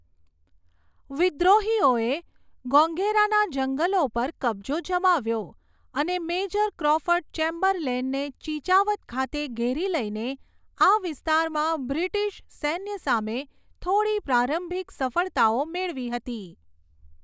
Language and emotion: Gujarati, neutral